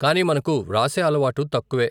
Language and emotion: Telugu, neutral